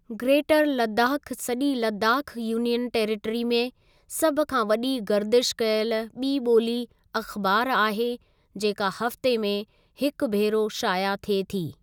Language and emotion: Sindhi, neutral